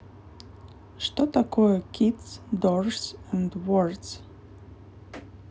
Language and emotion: Russian, neutral